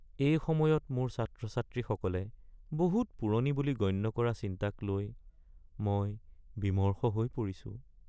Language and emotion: Assamese, sad